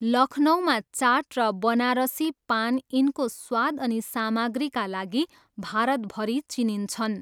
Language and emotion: Nepali, neutral